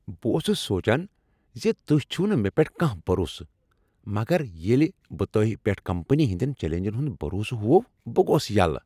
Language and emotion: Kashmiri, happy